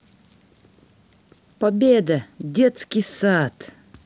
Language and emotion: Russian, positive